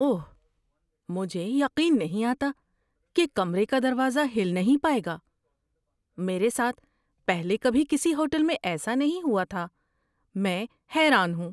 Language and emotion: Urdu, surprised